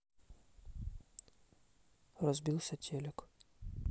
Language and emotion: Russian, neutral